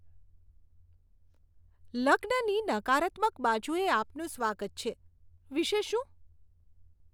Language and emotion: Gujarati, disgusted